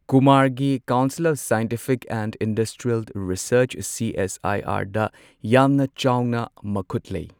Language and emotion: Manipuri, neutral